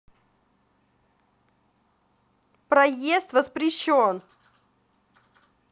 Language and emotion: Russian, neutral